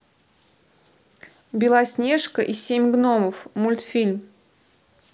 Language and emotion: Russian, neutral